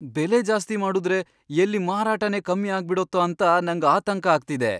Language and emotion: Kannada, fearful